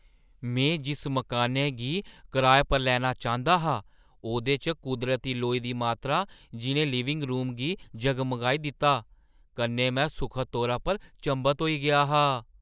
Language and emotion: Dogri, surprised